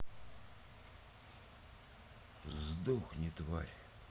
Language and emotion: Russian, neutral